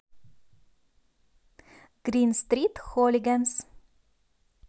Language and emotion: Russian, positive